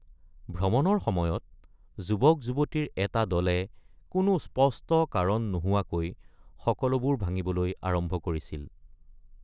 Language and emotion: Assamese, neutral